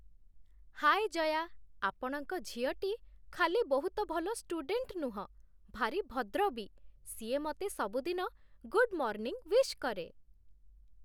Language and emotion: Odia, happy